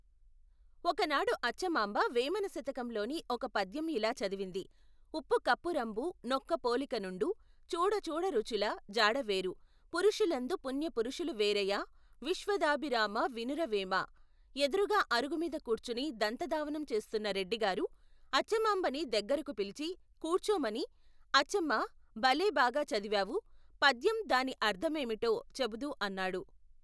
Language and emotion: Telugu, neutral